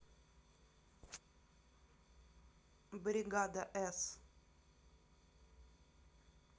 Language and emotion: Russian, neutral